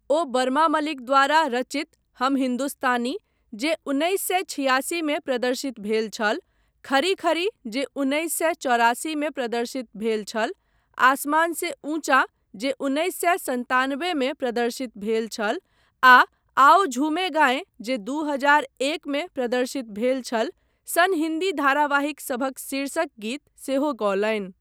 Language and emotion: Maithili, neutral